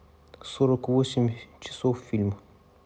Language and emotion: Russian, neutral